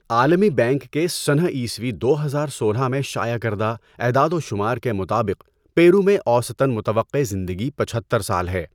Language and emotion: Urdu, neutral